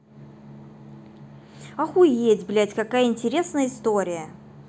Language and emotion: Russian, angry